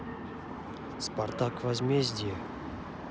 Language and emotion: Russian, neutral